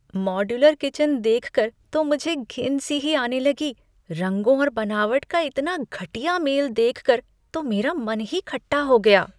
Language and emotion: Hindi, disgusted